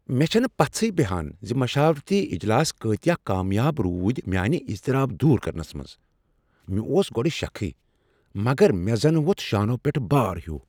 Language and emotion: Kashmiri, surprised